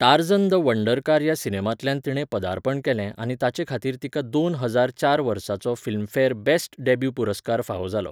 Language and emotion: Goan Konkani, neutral